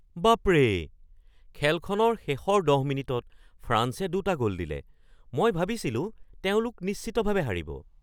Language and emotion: Assamese, surprised